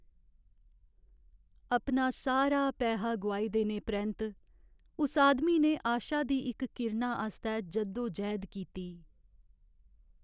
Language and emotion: Dogri, sad